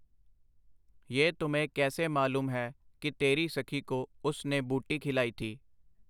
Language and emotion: Punjabi, neutral